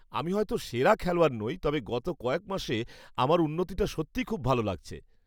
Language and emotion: Bengali, happy